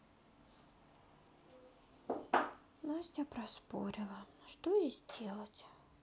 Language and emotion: Russian, sad